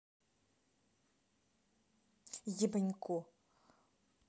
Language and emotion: Russian, angry